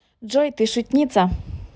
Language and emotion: Russian, positive